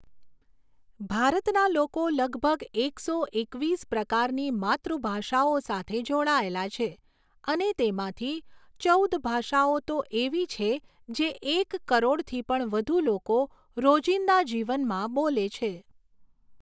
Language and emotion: Gujarati, neutral